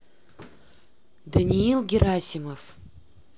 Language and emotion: Russian, neutral